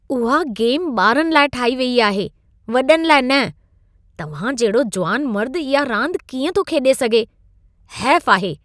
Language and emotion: Sindhi, disgusted